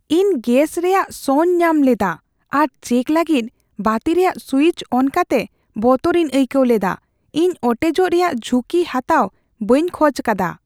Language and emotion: Santali, fearful